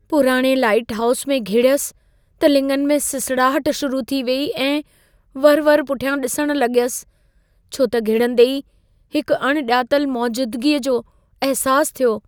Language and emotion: Sindhi, fearful